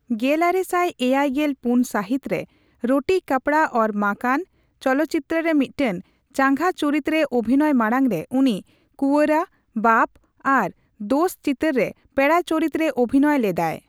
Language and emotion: Santali, neutral